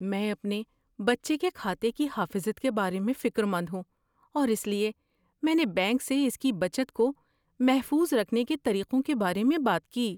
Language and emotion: Urdu, fearful